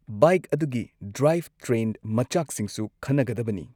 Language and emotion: Manipuri, neutral